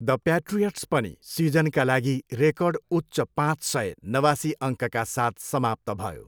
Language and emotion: Nepali, neutral